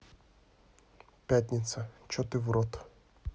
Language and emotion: Russian, neutral